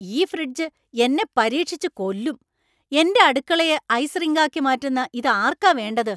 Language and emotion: Malayalam, angry